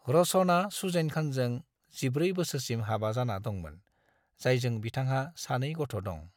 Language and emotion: Bodo, neutral